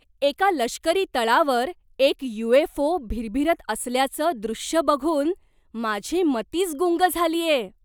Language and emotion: Marathi, surprised